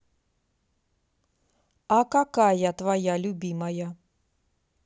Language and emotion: Russian, neutral